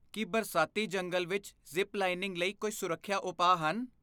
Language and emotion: Punjabi, fearful